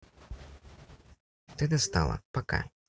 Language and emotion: Russian, neutral